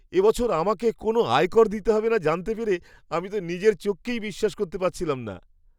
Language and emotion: Bengali, surprised